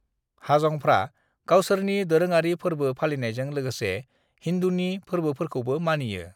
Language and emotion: Bodo, neutral